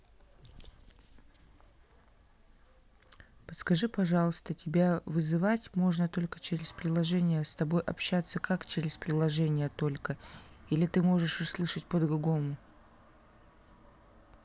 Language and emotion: Russian, neutral